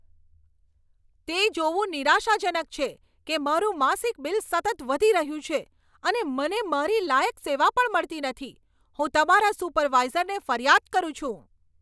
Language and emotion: Gujarati, angry